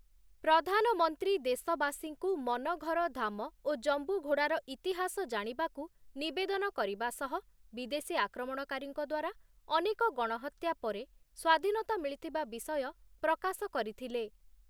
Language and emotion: Odia, neutral